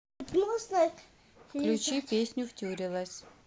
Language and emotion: Russian, neutral